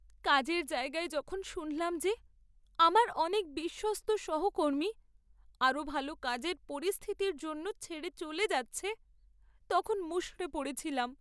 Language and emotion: Bengali, sad